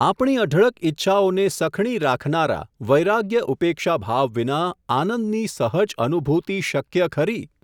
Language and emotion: Gujarati, neutral